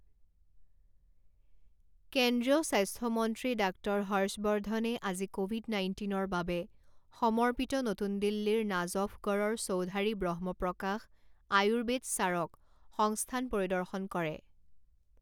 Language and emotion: Assamese, neutral